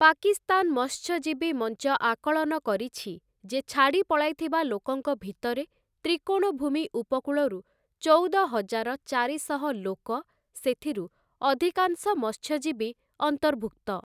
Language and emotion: Odia, neutral